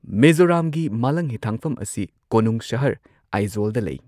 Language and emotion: Manipuri, neutral